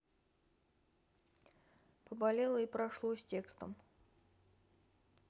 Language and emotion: Russian, neutral